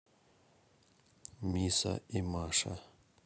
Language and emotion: Russian, neutral